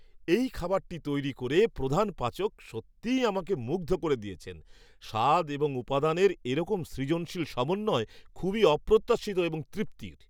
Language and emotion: Bengali, surprised